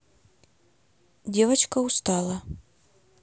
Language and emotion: Russian, neutral